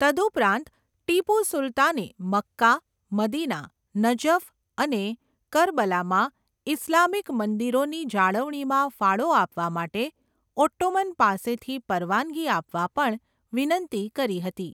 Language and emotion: Gujarati, neutral